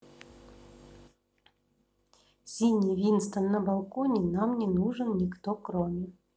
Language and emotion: Russian, neutral